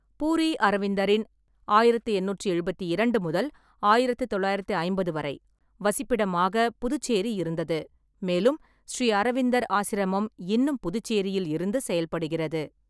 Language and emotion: Tamil, neutral